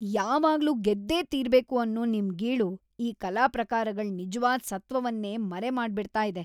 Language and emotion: Kannada, disgusted